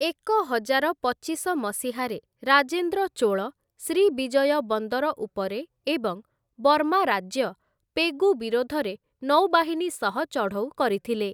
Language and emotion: Odia, neutral